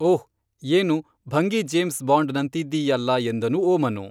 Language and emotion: Kannada, neutral